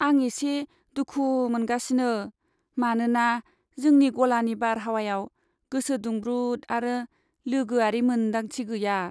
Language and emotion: Bodo, sad